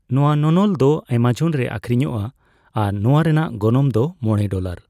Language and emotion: Santali, neutral